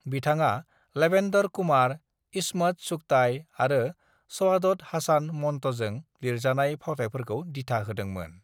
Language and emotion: Bodo, neutral